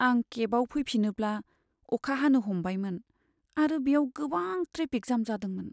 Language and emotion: Bodo, sad